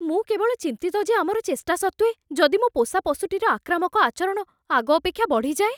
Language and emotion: Odia, fearful